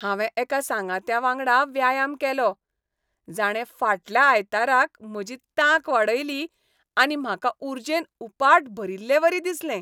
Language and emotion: Goan Konkani, happy